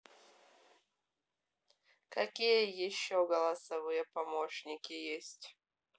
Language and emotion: Russian, neutral